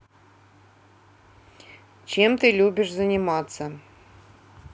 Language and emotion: Russian, neutral